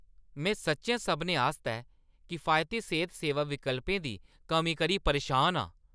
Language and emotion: Dogri, angry